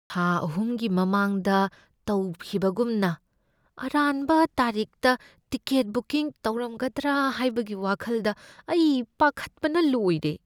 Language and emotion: Manipuri, fearful